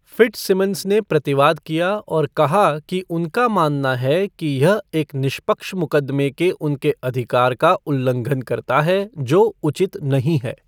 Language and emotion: Hindi, neutral